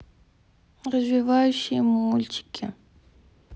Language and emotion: Russian, sad